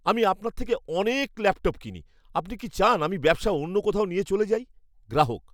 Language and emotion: Bengali, angry